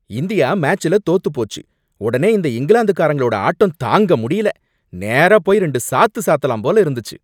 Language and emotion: Tamil, angry